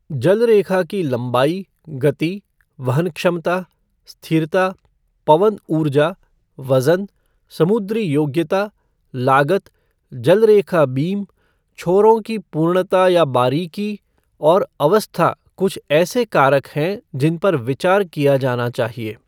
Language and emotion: Hindi, neutral